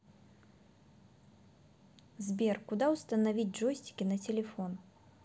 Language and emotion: Russian, neutral